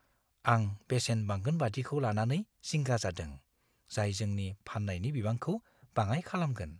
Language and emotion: Bodo, fearful